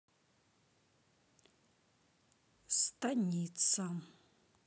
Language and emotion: Russian, neutral